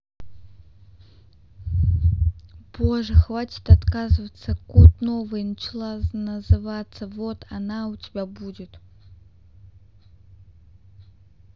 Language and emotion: Russian, sad